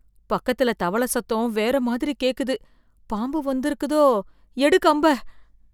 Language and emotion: Tamil, fearful